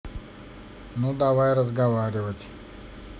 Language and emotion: Russian, neutral